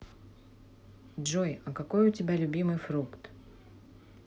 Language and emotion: Russian, neutral